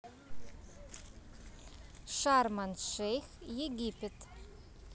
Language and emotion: Russian, neutral